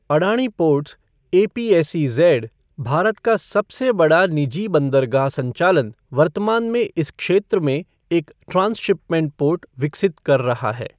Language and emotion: Hindi, neutral